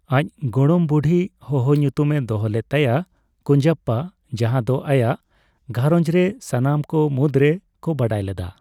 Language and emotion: Santali, neutral